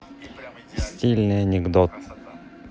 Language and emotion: Russian, neutral